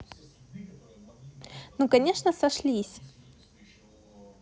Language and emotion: Russian, positive